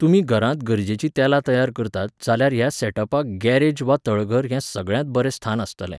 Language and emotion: Goan Konkani, neutral